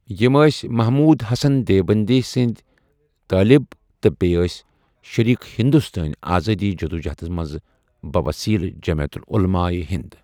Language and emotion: Kashmiri, neutral